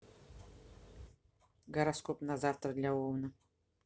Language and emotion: Russian, neutral